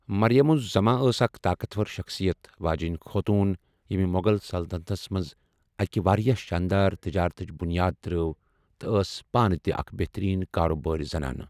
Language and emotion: Kashmiri, neutral